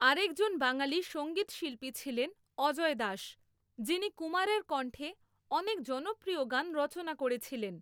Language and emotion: Bengali, neutral